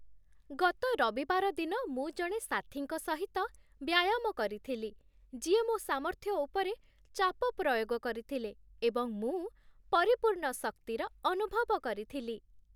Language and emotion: Odia, happy